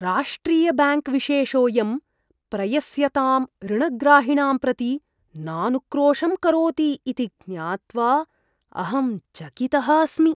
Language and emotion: Sanskrit, disgusted